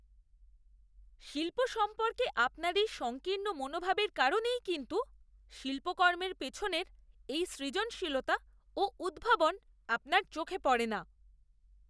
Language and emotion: Bengali, disgusted